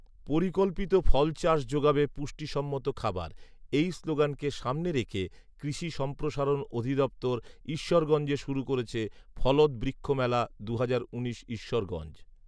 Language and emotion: Bengali, neutral